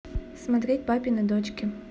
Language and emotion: Russian, neutral